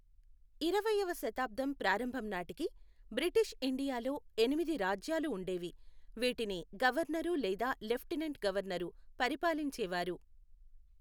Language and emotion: Telugu, neutral